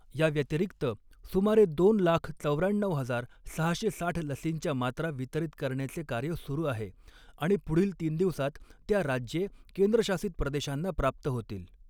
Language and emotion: Marathi, neutral